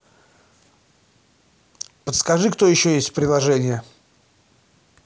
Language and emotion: Russian, neutral